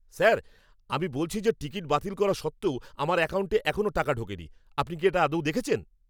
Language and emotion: Bengali, angry